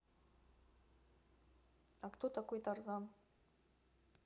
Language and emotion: Russian, neutral